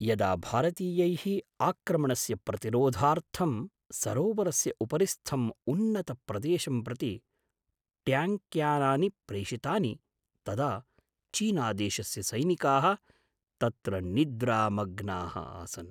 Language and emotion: Sanskrit, surprised